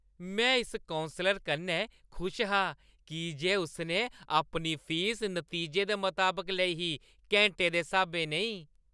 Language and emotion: Dogri, happy